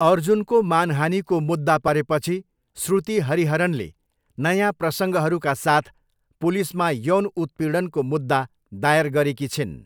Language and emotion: Nepali, neutral